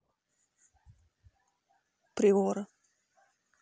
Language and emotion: Russian, neutral